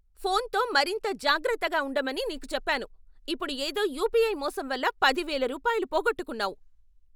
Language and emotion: Telugu, angry